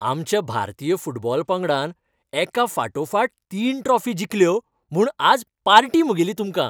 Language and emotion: Goan Konkani, happy